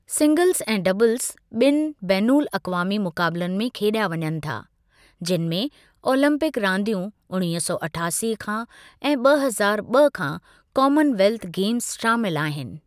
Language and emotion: Sindhi, neutral